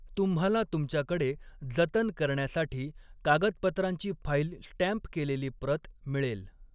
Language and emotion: Marathi, neutral